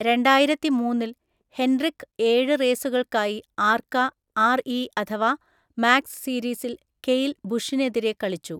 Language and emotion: Malayalam, neutral